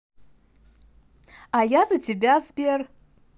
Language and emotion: Russian, positive